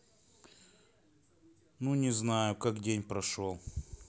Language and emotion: Russian, neutral